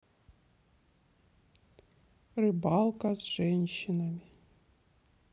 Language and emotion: Russian, sad